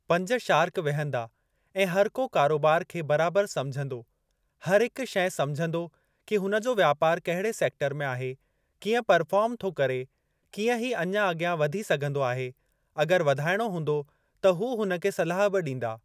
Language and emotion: Sindhi, neutral